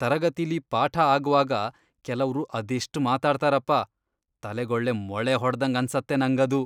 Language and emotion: Kannada, disgusted